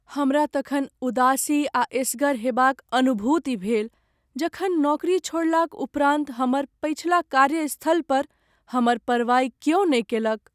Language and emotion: Maithili, sad